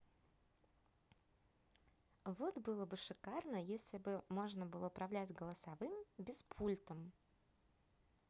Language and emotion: Russian, positive